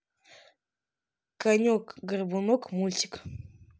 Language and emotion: Russian, neutral